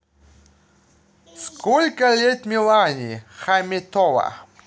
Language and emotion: Russian, neutral